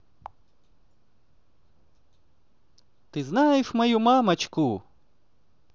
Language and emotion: Russian, positive